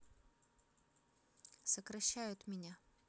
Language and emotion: Russian, neutral